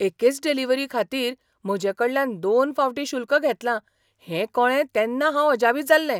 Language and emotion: Goan Konkani, surprised